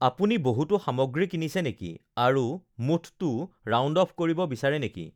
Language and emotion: Assamese, neutral